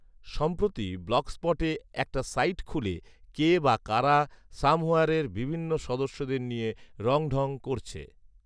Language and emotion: Bengali, neutral